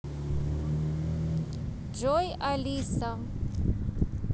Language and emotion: Russian, neutral